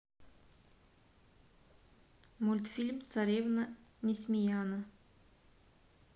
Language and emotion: Russian, neutral